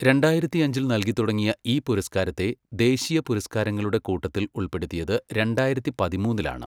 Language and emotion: Malayalam, neutral